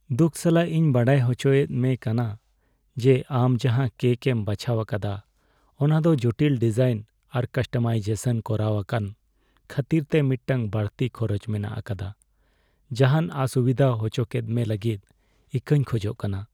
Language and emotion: Santali, sad